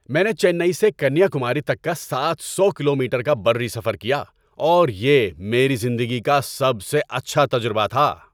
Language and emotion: Urdu, happy